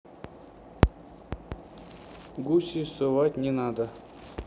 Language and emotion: Russian, neutral